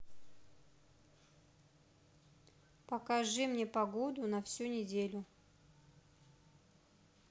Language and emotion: Russian, neutral